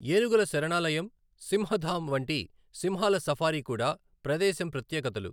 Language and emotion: Telugu, neutral